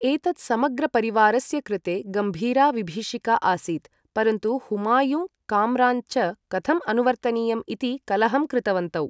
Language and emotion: Sanskrit, neutral